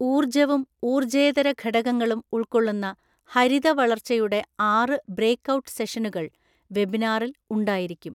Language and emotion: Malayalam, neutral